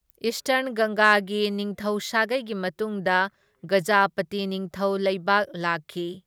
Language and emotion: Manipuri, neutral